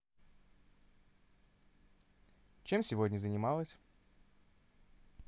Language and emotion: Russian, positive